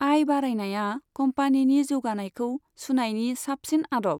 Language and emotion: Bodo, neutral